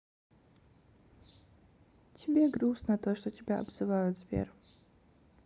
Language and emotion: Russian, sad